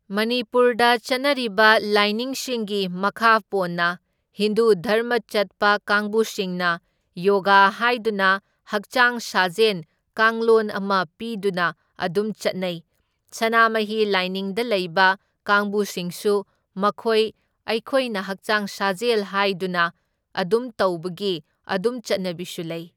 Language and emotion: Manipuri, neutral